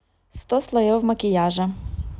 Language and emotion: Russian, neutral